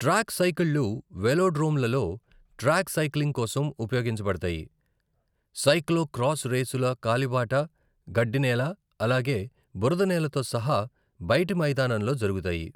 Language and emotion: Telugu, neutral